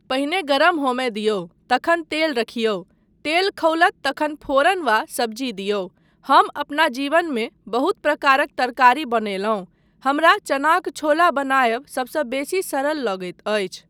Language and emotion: Maithili, neutral